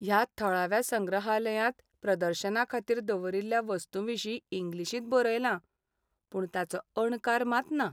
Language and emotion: Goan Konkani, sad